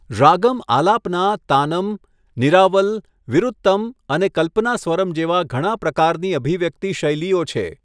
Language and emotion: Gujarati, neutral